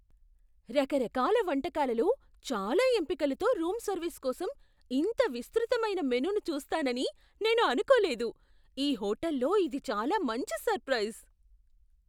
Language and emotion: Telugu, surprised